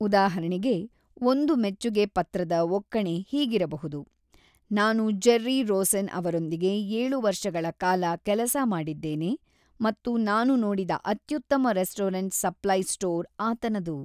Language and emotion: Kannada, neutral